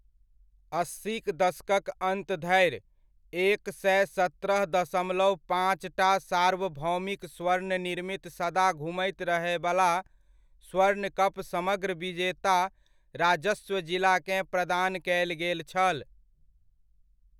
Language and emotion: Maithili, neutral